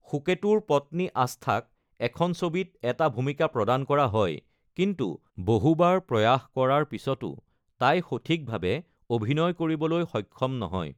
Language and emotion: Assamese, neutral